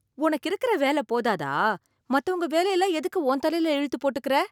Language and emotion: Tamil, surprised